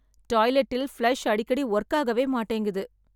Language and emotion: Tamil, sad